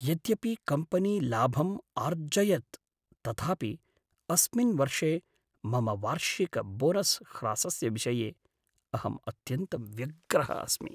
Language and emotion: Sanskrit, sad